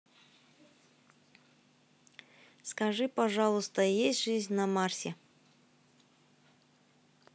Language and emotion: Russian, neutral